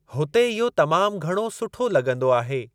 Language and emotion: Sindhi, neutral